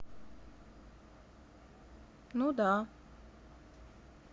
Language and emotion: Russian, neutral